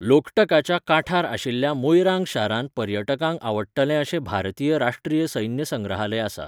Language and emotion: Goan Konkani, neutral